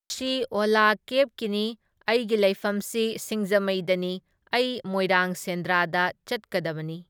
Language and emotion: Manipuri, neutral